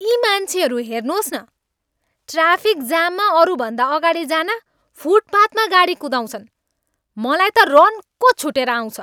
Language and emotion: Nepali, angry